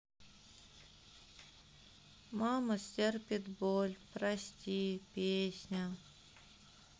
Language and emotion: Russian, sad